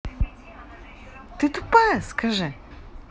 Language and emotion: Russian, angry